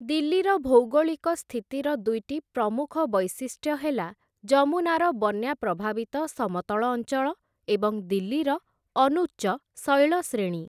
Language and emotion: Odia, neutral